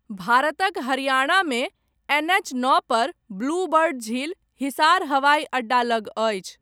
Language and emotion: Maithili, neutral